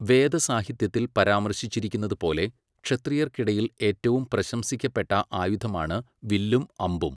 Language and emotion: Malayalam, neutral